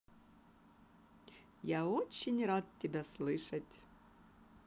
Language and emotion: Russian, positive